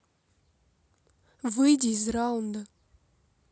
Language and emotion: Russian, neutral